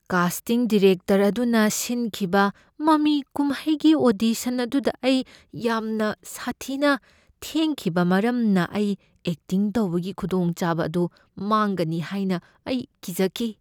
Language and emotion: Manipuri, fearful